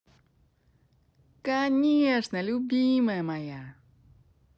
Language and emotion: Russian, positive